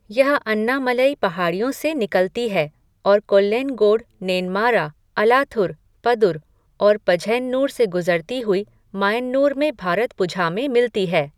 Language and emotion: Hindi, neutral